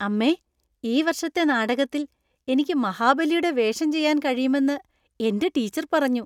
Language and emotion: Malayalam, happy